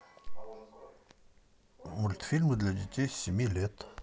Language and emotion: Russian, neutral